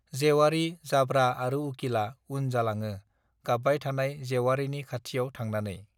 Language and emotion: Bodo, neutral